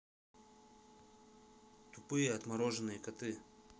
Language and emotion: Russian, neutral